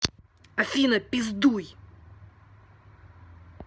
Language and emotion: Russian, angry